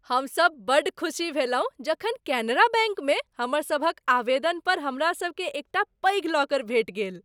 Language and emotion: Maithili, happy